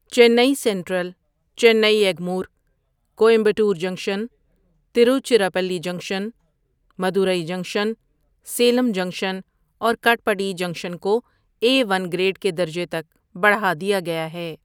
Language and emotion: Urdu, neutral